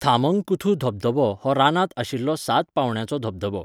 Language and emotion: Goan Konkani, neutral